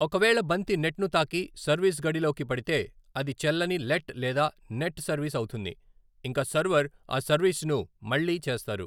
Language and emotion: Telugu, neutral